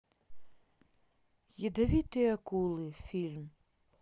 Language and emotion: Russian, neutral